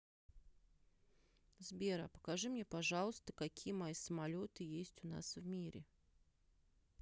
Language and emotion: Russian, neutral